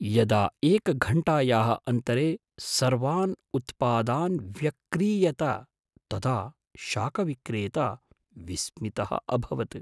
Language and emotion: Sanskrit, surprised